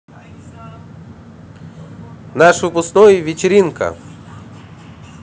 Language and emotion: Russian, positive